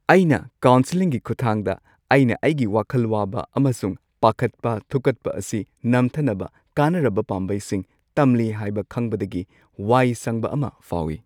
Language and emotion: Manipuri, happy